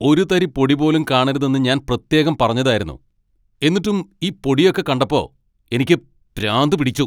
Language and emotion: Malayalam, angry